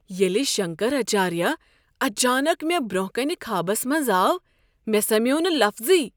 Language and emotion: Kashmiri, surprised